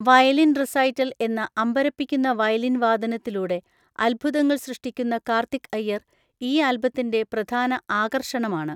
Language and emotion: Malayalam, neutral